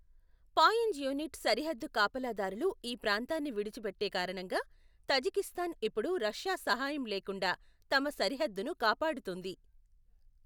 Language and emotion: Telugu, neutral